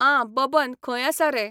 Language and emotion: Goan Konkani, neutral